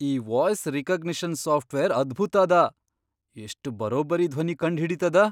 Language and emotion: Kannada, surprised